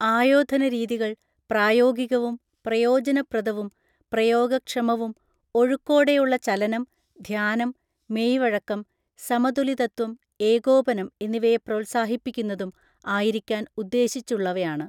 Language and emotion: Malayalam, neutral